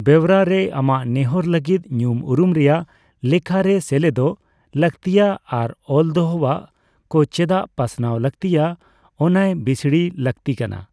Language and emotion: Santali, neutral